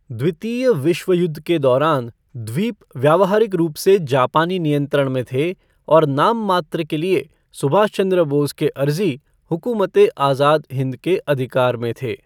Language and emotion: Hindi, neutral